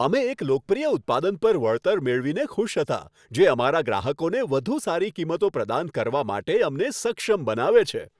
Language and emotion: Gujarati, happy